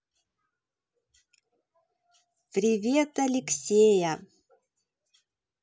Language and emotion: Russian, positive